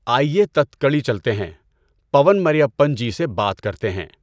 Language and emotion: Urdu, neutral